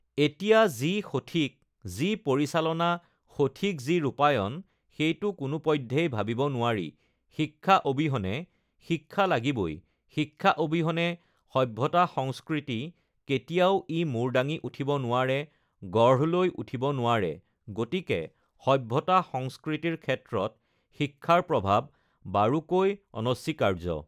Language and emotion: Assamese, neutral